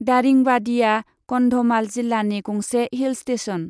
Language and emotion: Bodo, neutral